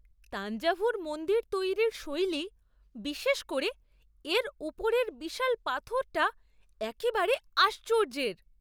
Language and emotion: Bengali, surprised